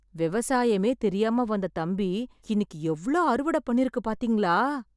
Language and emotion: Tamil, surprised